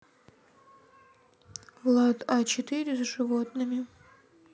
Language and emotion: Russian, sad